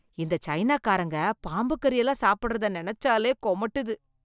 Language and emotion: Tamil, disgusted